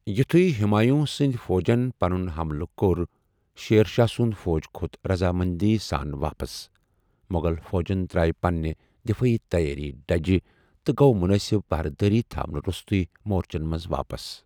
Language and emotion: Kashmiri, neutral